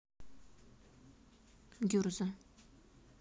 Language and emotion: Russian, neutral